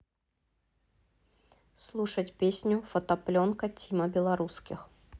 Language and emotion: Russian, neutral